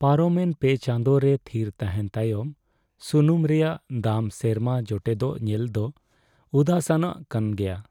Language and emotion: Santali, sad